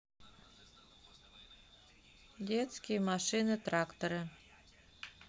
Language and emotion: Russian, neutral